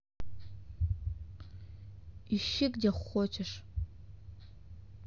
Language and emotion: Russian, neutral